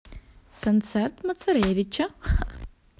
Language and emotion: Russian, positive